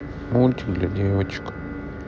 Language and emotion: Russian, sad